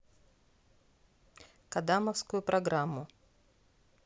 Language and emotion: Russian, neutral